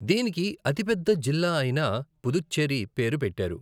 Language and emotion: Telugu, neutral